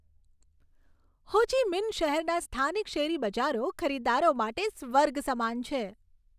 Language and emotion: Gujarati, happy